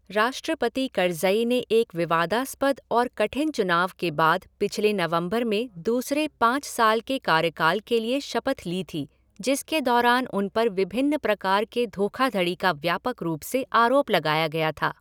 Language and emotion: Hindi, neutral